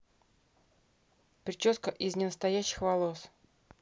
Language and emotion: Russian, neutral